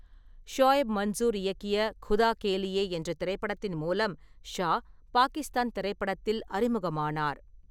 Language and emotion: Tamil, neutral